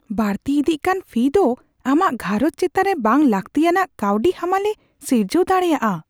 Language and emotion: Santali, fearful